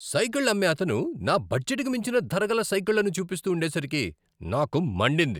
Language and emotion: Telugu, angry